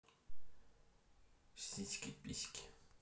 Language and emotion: Russian, neutral